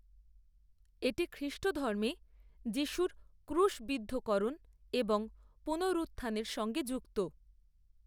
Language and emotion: Bengali, neutral